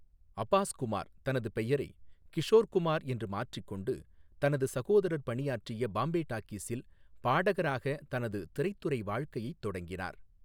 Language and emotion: Tamil, neutral